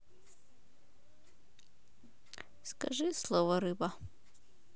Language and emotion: Russian, neutral